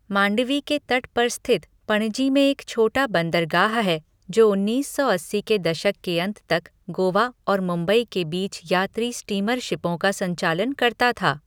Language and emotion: Hindi, neutral